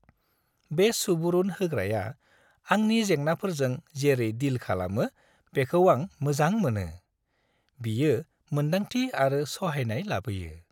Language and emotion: Bodo, happy